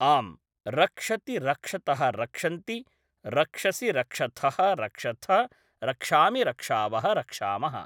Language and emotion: Sanskrit, neutral